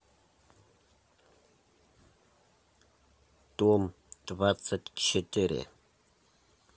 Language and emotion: Russian, neutral